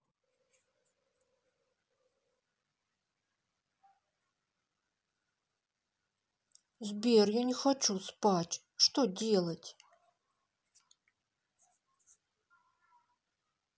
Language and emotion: Russian, sad